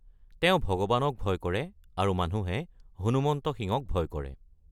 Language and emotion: Assamese, neutral